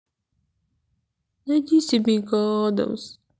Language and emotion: Russian, sad